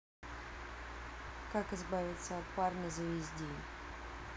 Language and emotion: Russian, neutral